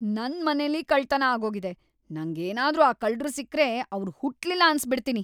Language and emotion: Kannada, angry